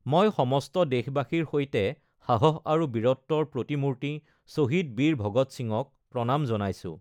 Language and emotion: Assamese, neutral